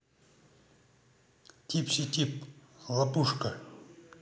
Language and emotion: Russian, neutral